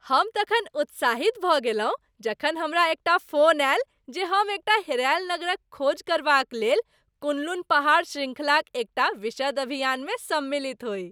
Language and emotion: Maithili, happy